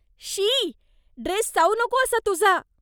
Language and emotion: Marathi, disgusted